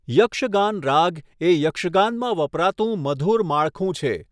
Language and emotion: Gujarati, neutral